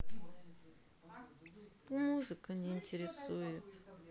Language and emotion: Russian, sad